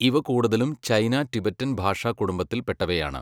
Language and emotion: Malayalam, neutral